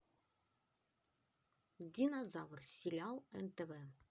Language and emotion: Russian, positive